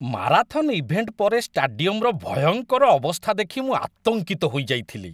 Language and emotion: Odia, disgusted